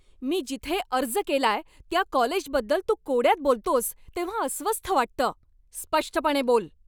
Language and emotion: Marathi, angry